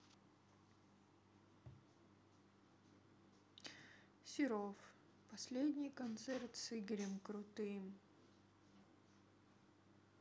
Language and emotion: Russian, sad